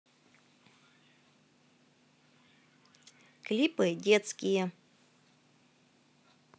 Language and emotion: Russian, positive